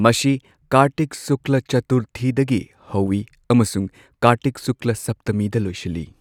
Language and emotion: Manipuri, neutral